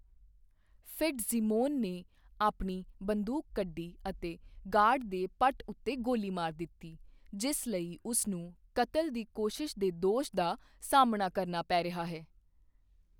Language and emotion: Punjabi, neutral